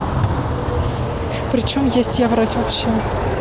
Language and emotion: Russian, angry